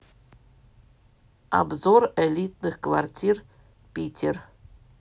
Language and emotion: Russian, neutral